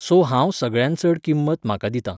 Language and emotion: Goan Konkani, neutral